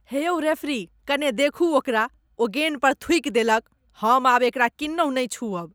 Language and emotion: Maithili, disgusted